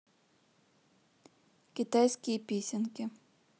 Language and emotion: Russian, neutral